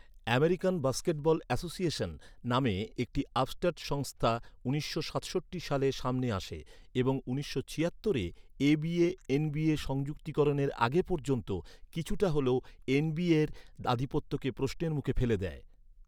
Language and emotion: Bengali, neutral